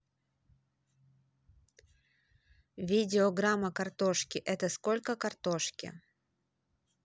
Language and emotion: Russian, neutral